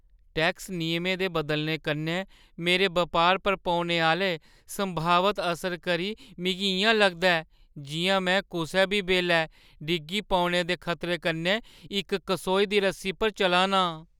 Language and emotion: Dogri, fearful